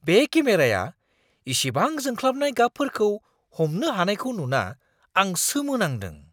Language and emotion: Bodo, surprised